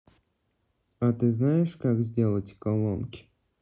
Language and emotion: Russian, neutral